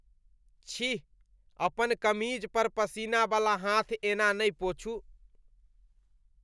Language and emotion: Maithili, disgusted